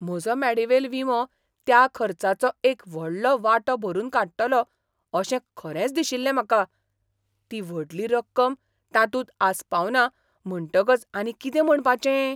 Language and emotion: Goan Konkani, surprised